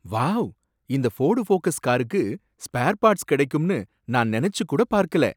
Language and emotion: Tamil, surprised